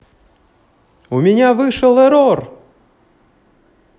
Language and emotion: Russian, positive